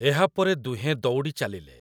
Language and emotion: Odia, neutral